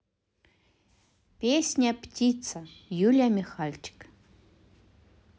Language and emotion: Russian, positive